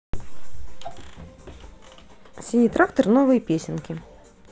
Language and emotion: Russian, neutral